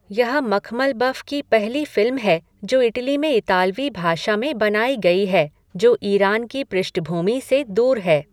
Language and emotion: Hindi, neutral